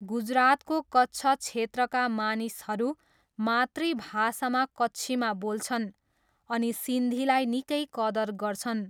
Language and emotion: Nepali, neutral